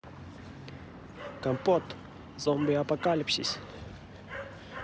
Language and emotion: Russian, positive